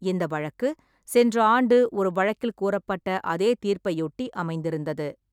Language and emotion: Tamil, neutral